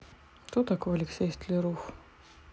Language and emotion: Russian, neutral